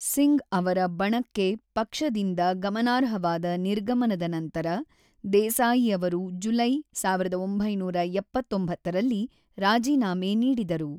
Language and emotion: Kannada, neutral